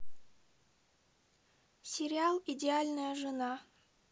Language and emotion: Russian, neutral